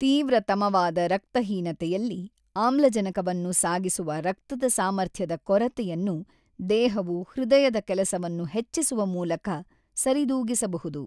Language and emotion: Kannada, neutral